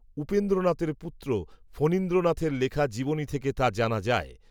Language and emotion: Bengali, neutral